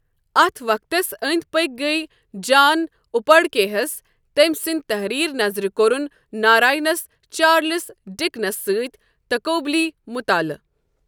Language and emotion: Kashmiri, neutral